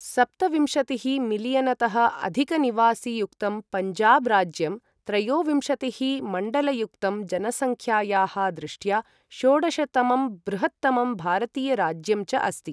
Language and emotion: Sanskrit, neutral